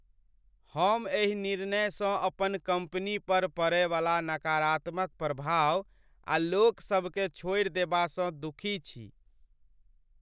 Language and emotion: Maithili, sad